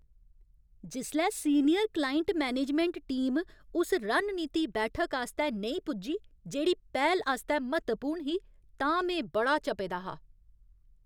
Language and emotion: Dogri, angry